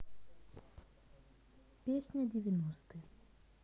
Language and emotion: Russian, neutral